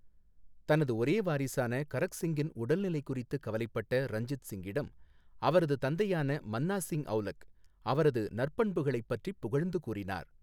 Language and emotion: Tamil, neutral